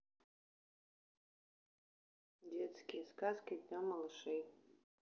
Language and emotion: Russian, neutral